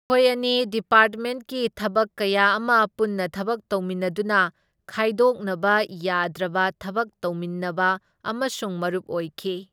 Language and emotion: Manipuri, neutral